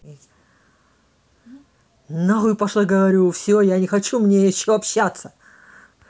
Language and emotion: Russian, angry